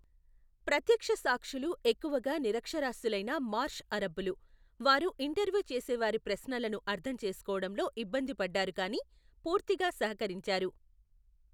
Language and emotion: Telugu, neutral